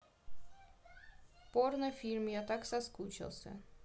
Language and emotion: Russian, neutral